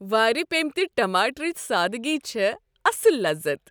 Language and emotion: Kashmiri, happy